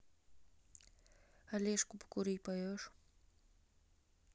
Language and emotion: Russian, neutral